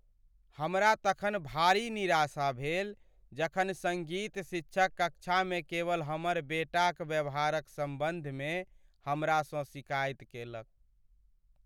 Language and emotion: Maithili, sad